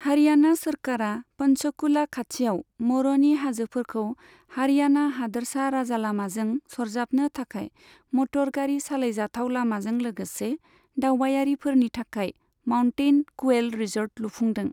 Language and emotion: Bodo, neutral